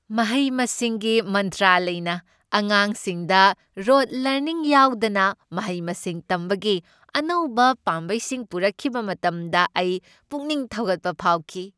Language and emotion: Manipuri, happy